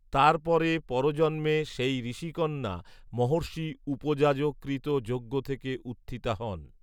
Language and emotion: Bengali, neutral